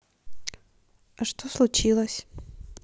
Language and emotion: Russian, neutral